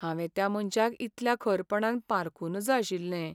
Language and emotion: Goan Konkani, sad